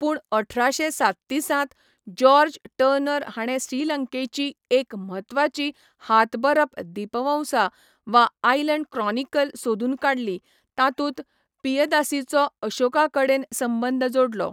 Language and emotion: Goan Konkani, neutral